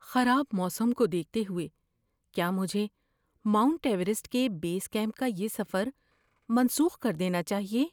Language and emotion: Urdu, fearful